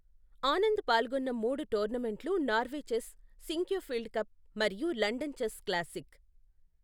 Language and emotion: Telugu, neutral